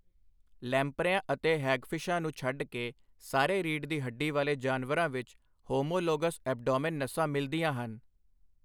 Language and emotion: Punjabi, neutral